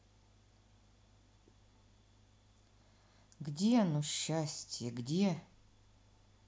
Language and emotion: Russian, sad